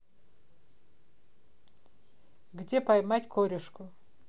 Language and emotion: Russian, neutral